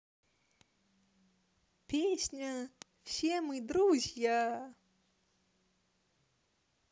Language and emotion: Russian, positive